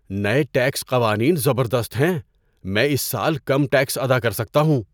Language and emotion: Urdu, surprised